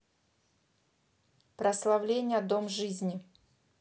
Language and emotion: Russian, neutral